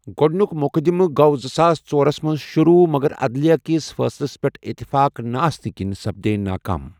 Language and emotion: Kashmiri, neutral